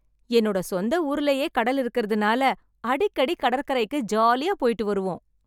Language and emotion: Tamil, happy